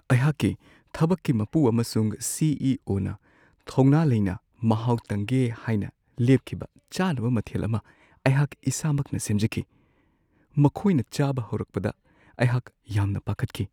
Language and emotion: Manipuri, fearful